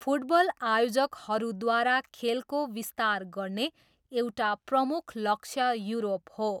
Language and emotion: Nepali, neutral